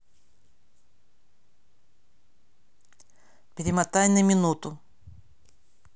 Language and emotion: Russian, neutral